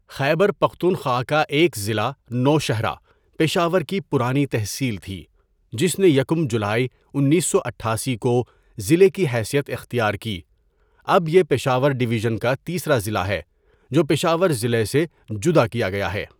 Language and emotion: Urdu, neutral